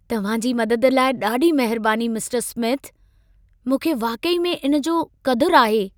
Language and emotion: Sindhi, happy